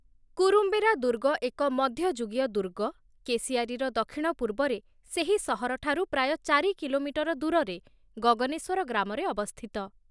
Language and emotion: Odia, neutral